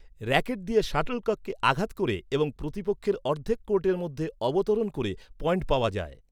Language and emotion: Bengali, neutral